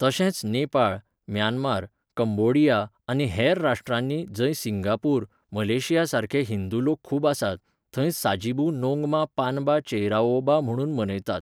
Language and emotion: Goan Konkani, neutral